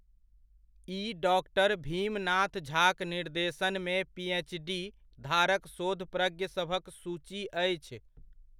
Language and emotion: Maithili, neutral